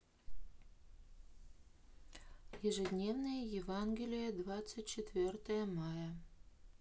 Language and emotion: Russian, neutral